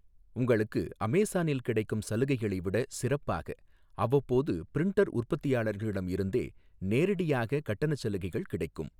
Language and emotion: Tamil, neutral